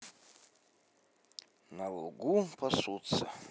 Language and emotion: Russian, neutral